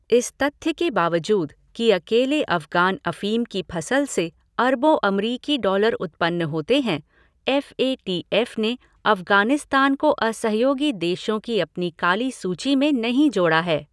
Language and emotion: Hindi, neutral